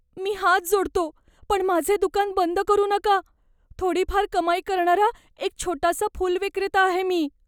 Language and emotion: Marathi, fearful